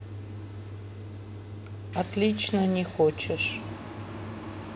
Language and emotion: Russian, neutral